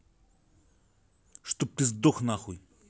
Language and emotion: Russian, angry